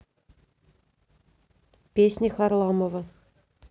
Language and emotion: Russian, neutral